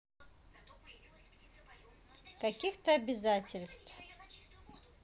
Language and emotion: Russian, neutral